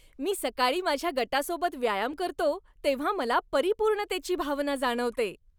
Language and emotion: Marathi, happy